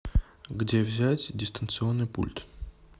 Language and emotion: Russian, neutral